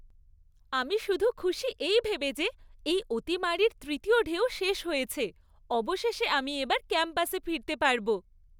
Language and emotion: Bengali, happy